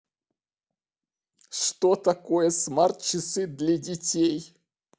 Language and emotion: Russian, positive